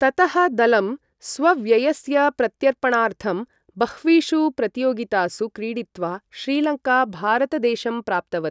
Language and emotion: Sanskrit, neutral